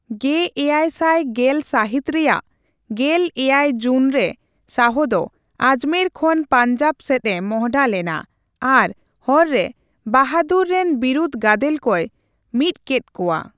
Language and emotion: Santali, neutral